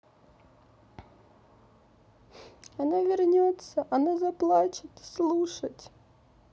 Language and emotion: Russian, sad